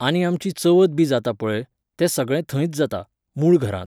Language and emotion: Goan Konkani, neutral